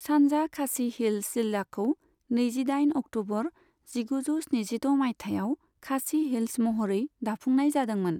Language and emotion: Bodo, neutral